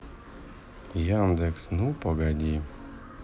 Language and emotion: Russian, sad